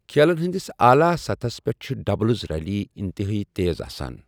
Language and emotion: Kashmiri, neutral